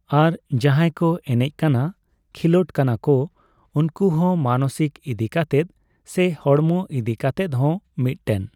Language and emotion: Santali, neutral